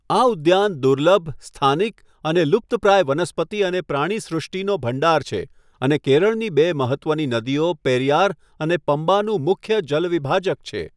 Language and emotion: Gujarati, neutral